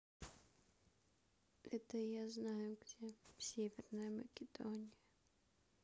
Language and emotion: Russian, sad